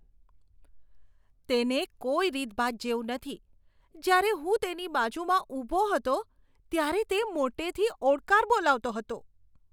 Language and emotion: Gujarati, disgusted